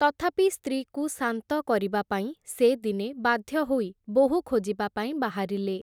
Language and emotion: Odia, neutral